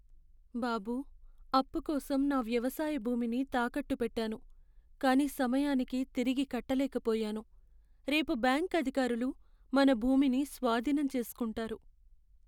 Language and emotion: Telugu, sad